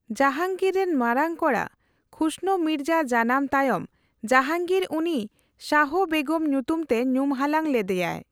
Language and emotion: Santali, neutral